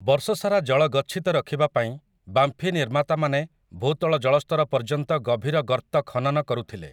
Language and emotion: Odia, neutral